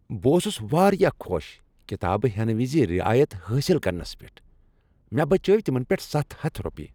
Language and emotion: Kashmiri, happy